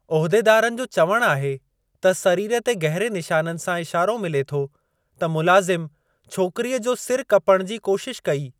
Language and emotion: Sindhi, neutral